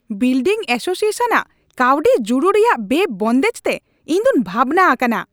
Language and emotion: Santali, angry